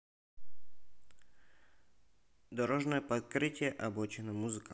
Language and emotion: Russian, neutral